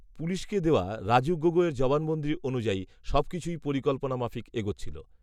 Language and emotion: Bengali, neutral